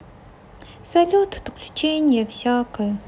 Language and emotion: Russian, sad